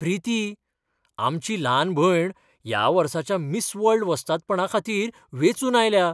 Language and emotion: Goan Konkani, surprised